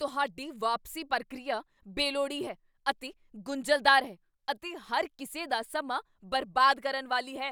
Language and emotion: Punjabi, angry